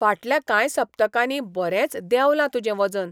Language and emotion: Goan Konkani, surprised